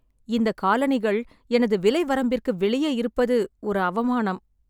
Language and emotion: Tamil, sad